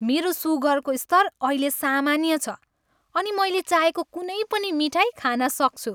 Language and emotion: Nepali, happy